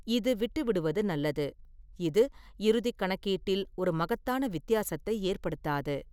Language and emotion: Tamil, neutral